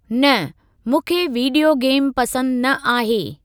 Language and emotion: Sindhi, neutral